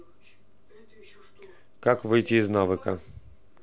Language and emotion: Russian, neutral